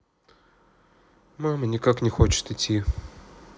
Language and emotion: Russian, sad